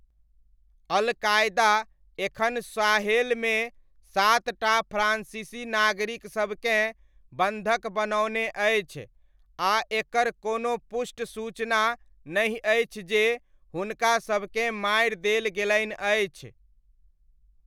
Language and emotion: Maithili, neutral